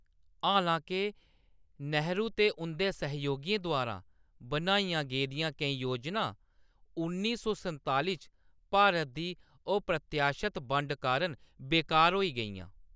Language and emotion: Dogri, neutral